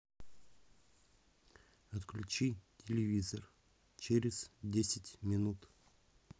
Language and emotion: Russian, neutral